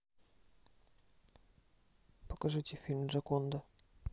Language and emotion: Russian, neutral